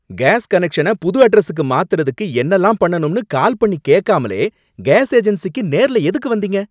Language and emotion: Tamil, angry